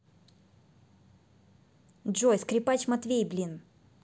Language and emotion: Russian, angry